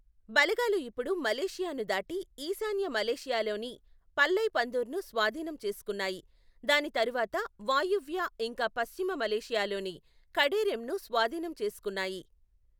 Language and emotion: Telugu, neutral